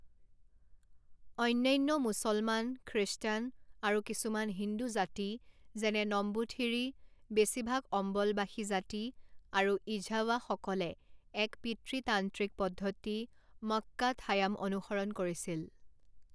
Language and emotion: Assamese, neutral